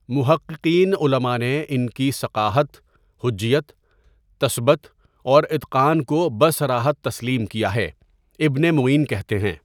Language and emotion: Urdu, neutral